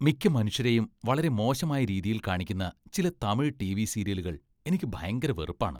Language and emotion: Malayalam, disgusted